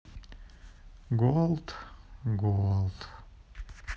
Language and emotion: Russian, sad